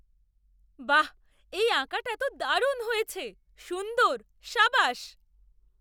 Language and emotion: Bengali, surprised